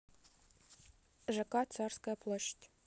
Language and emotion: Russian, neutral